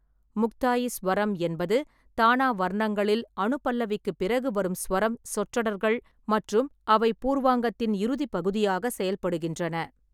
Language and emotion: Tamil, neutral